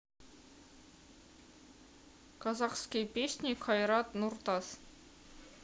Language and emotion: Russian, neutral